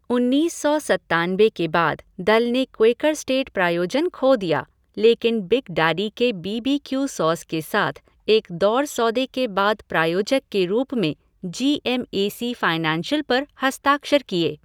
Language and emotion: Hindi, neutral